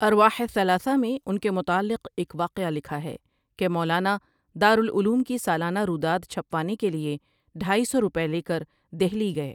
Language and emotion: Urdu, neutral